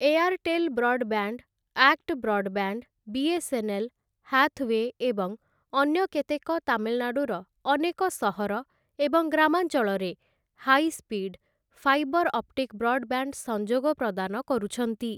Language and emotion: Odia, neutral